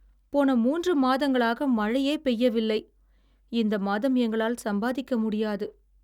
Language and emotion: Tamil, sad